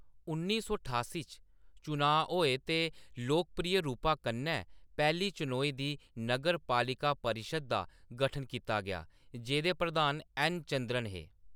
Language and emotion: Dogri, neutral